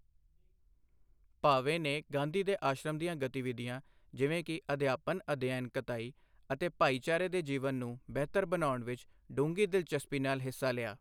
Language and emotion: Punjabi, neutral